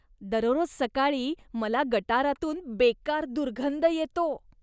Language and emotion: Marathi, disgusted